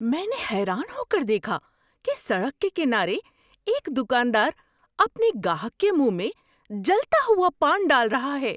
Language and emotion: Urdu, surprised